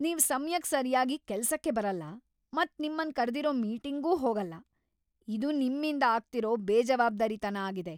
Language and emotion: Kannada, angry